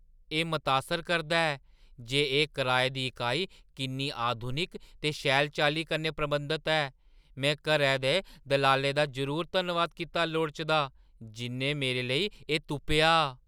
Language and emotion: Dogri, surprised